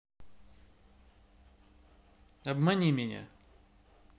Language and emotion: Russian, neutral